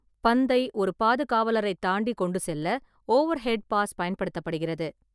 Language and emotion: Tamil, neutral